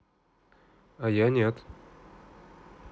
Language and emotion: Russian, neutral